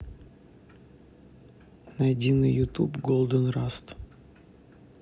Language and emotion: Russian, neutral